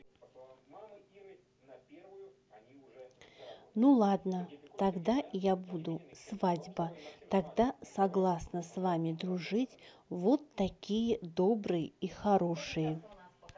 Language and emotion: Russian, neutral